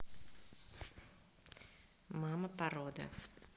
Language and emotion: Russian, neutral